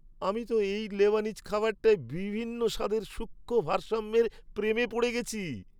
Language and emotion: Bengali, happy